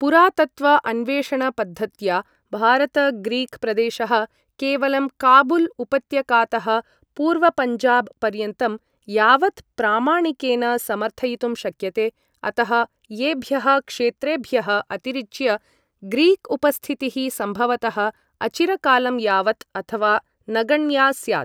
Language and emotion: Sanskrit, neutral